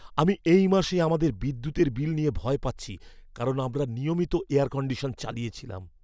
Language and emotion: Bengali, fearful